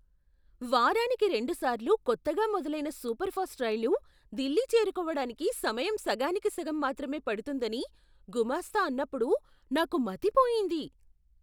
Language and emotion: Telugu, surprised